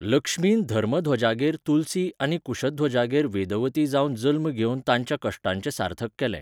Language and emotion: Goan Konkani, neutral